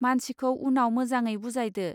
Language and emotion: Bodo, neutral